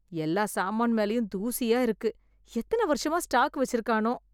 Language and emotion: Tamil, disgusted